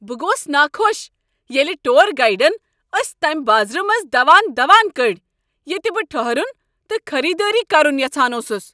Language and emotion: Kashmiri, angry